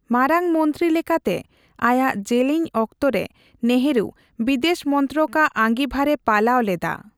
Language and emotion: Santali, neutral